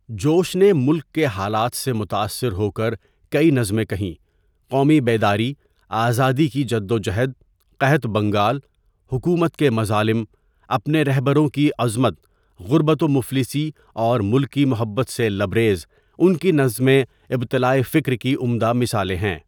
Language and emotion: Urdu, neutral